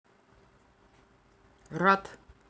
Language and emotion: Russian, neutral